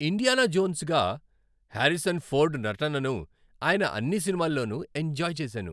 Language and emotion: Telugu, happy